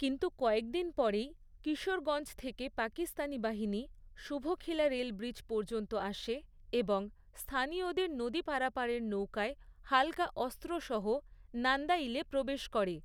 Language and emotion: Bengali, neutral